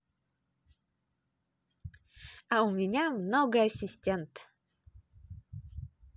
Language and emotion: Russian, positive